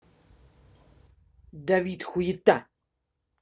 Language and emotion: Russian, angry